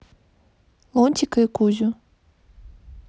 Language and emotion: Russian, neutral